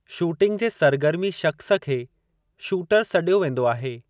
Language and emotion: Sindhi, neutral